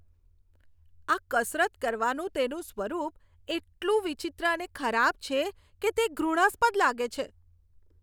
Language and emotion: Gujarati, disgusted